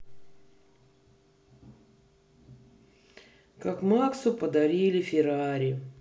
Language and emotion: Russian, sad